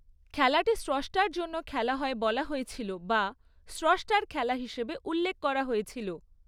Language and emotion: Bengali, neutral